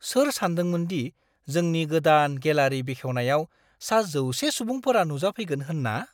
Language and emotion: Bodo, surprised